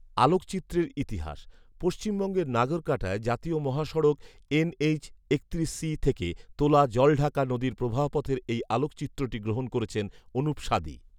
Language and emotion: Bengali, neutral